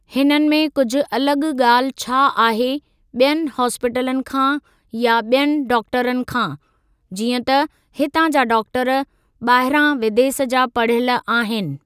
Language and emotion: Sindhi, neutral